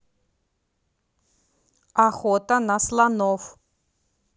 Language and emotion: Russian, neutral